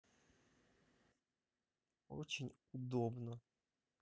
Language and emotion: Russian, neutral